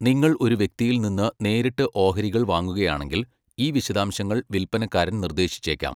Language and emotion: Malayalam, neutral